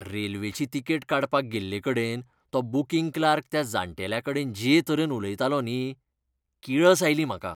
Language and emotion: Goan Konkani, disgusted